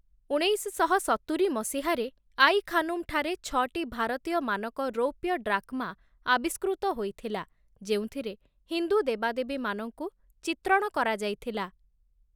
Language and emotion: Odia, neutral